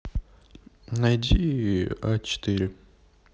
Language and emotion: Russian, neutral